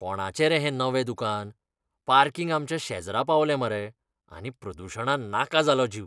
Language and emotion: Goan Konkani, disgusted